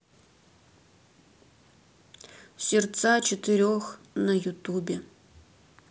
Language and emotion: Russian, neutral